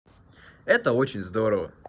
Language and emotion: Russian, positive